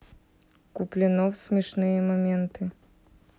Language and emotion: Russian, neutral